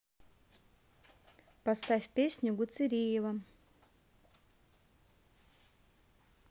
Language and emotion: Russian, neutral